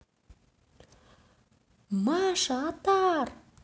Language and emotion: Russian, positive